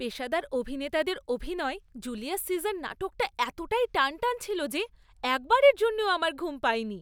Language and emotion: Bengali, happy